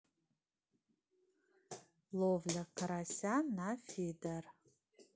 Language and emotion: Russian, neutral